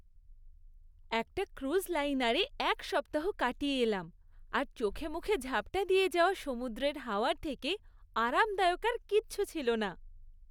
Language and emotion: Bengali, happy